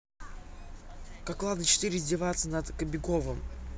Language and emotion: Russian, angry